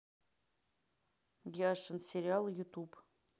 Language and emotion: Russian, neutral